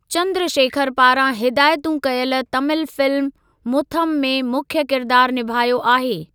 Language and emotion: Sindhi, neutral